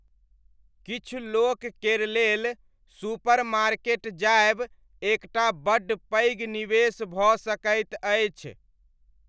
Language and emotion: Maithili, neutral